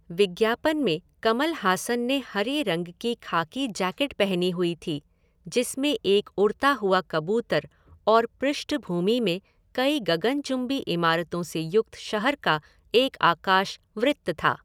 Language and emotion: Hindi, neutral